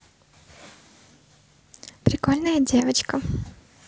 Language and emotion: Russian, positive